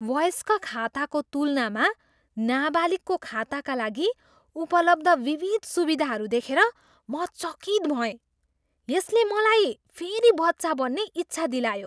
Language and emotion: Nepali, surprised